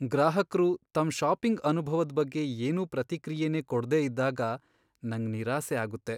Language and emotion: Kannada, sad